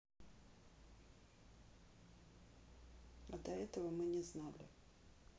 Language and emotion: Russian, neutral